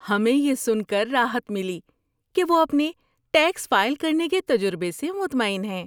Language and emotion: Urdu, happy